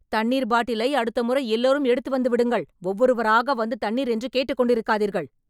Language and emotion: Tamil, angry